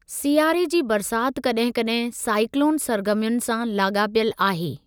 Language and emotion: Sindhi, neutral